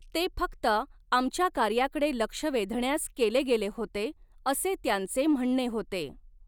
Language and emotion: Marathi, neutral